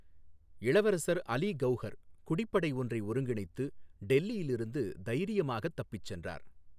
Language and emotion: Tamil, neutral